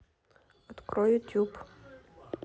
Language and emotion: Russian, neutral